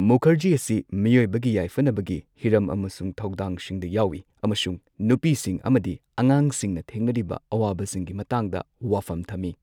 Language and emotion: Manipuri, neutral